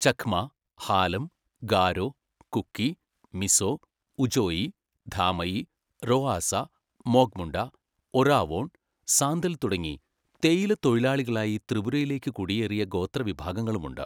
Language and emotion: Malayalam, neutral